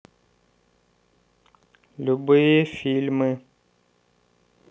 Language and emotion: Russian, neutral